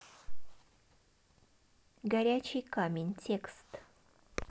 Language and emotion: Russian, neutral